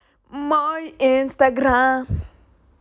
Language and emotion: Russian, positive